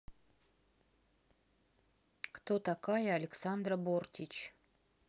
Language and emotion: Russian, neutral